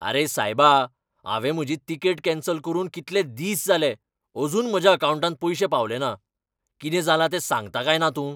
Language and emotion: Goan Konkani, angry